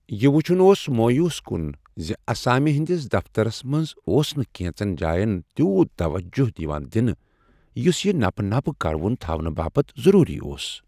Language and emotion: Kashmiri, sad